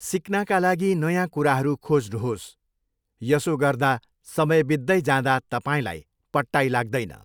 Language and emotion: Nepali, neutral